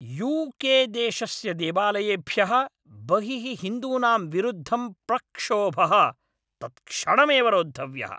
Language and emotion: Sanskrit, angry